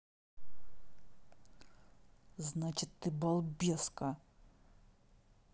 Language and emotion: Russian, angry